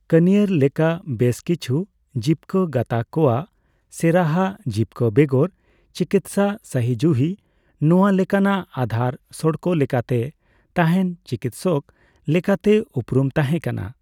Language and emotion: Santali, neutral